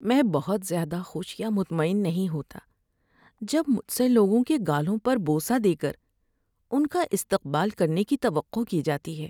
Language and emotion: Urdu, sad